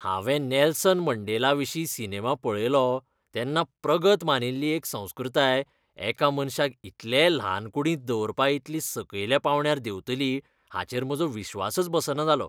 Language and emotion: Goan Konkani, disgusted